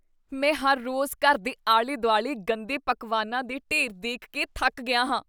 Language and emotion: Punjabi, disgusted